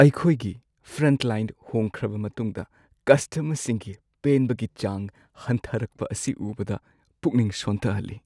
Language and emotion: Manipuri, sad